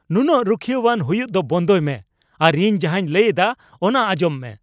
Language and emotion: Santali, angry